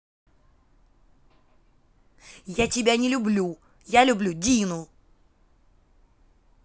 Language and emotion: Russian, angry